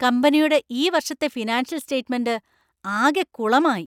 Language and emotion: Malayalam, angry